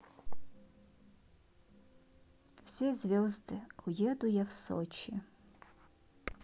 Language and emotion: Russian, neutral